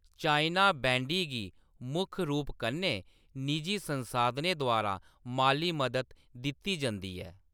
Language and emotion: Dogri, neutral